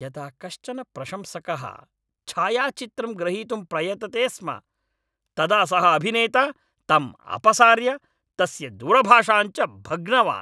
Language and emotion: Sanskrit, angry